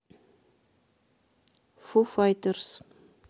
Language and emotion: Russian, neutral